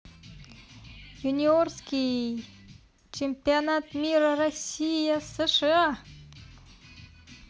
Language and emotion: Russian, positive